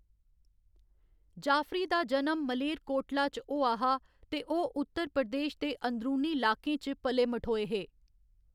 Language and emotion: Dogri, neutral